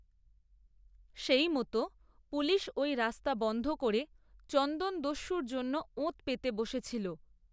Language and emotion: Bengali, neutral